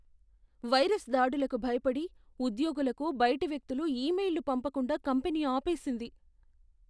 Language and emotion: Telugu, fearful